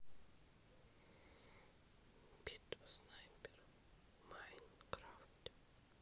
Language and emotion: Russian, neutral